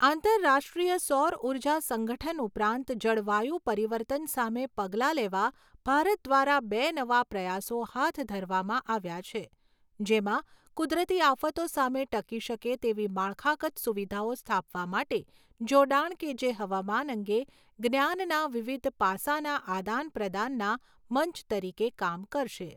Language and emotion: Gujarati, neutral